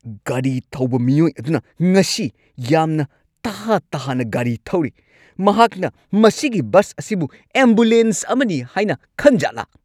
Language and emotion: Manipuri, angry